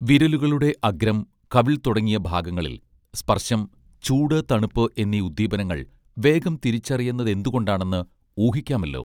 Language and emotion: Malayalam, neutral